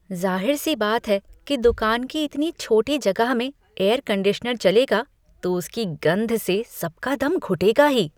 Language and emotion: Hindi, disgusted